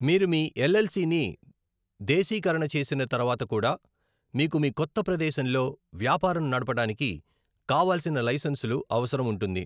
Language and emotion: Telugu, neutral